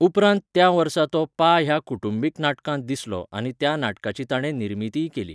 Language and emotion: Goan Konkani, neutral